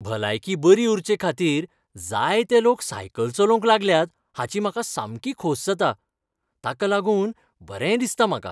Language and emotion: Goan Konkani, happy